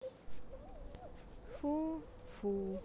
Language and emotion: Russian, neutral